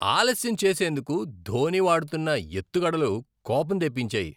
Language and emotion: Telugu, disgusted